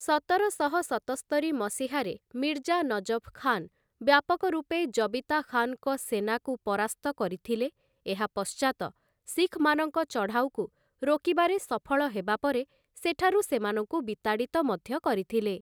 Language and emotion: Odia, neutral